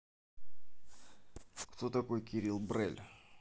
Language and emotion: Russian, neutral